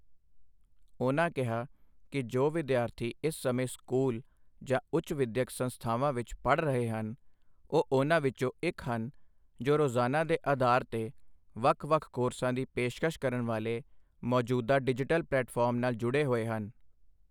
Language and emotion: Punjabi, neutral